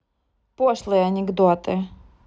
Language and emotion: Russian, neutral